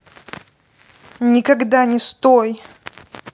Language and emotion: Russian, angry